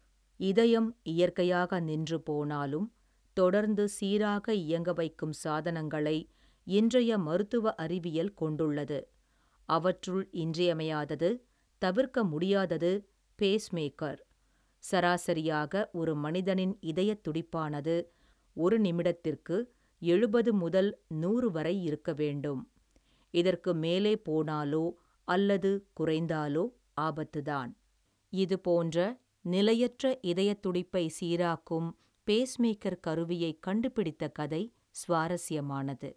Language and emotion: Tamil, neutral